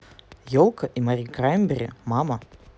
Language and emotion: Russian, neutral